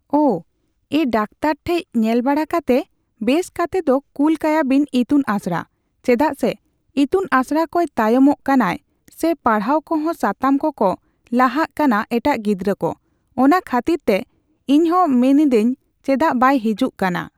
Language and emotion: Santali, neutral